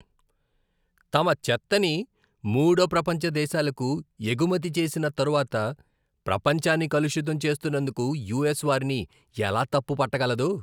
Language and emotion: Telugu, disgusted